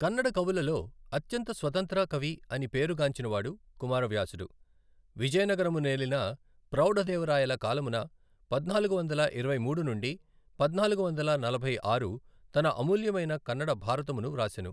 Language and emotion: Telugu, neutral